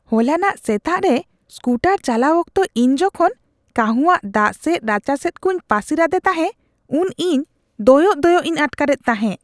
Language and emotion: Santali, disgusted